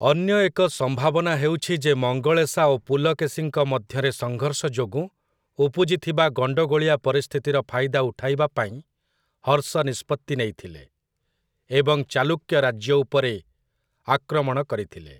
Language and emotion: Odia, neutral